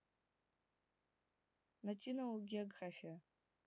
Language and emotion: Russian, neutral